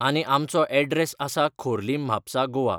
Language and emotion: Goan Konkani, neutral